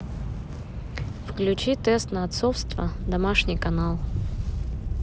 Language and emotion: Russian, neutral